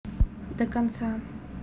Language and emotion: Russian, neutral